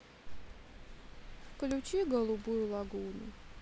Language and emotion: Russian, sad